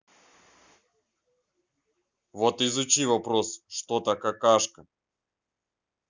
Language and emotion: Russian, neutral